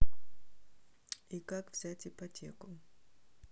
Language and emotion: Russian, neutral